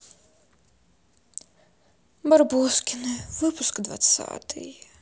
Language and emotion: Russian, sad